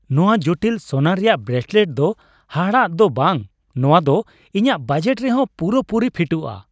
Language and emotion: Santali, happy